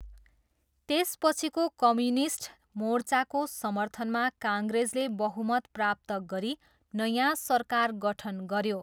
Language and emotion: Nepali, neutral